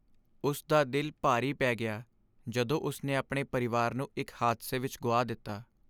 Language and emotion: Punjabi, sad